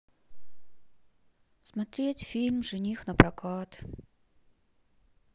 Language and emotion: Russian, sad